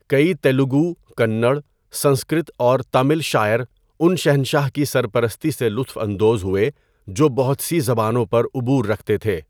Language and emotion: Urdu, neutral